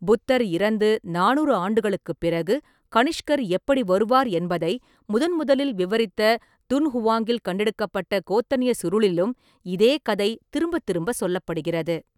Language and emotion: Tamil, neutral